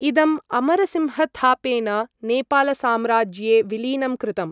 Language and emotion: Sanskrit, neutral